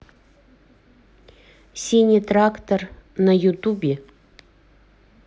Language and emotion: Russian, neutral